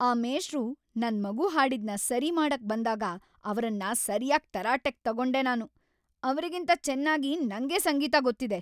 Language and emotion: Kannada, angry